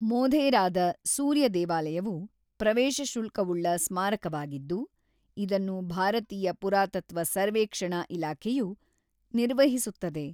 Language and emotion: Kannada, neutral